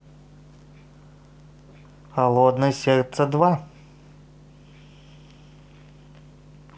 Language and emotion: Russian, positive